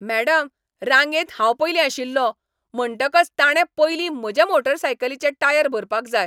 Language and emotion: Goan Konkani, angry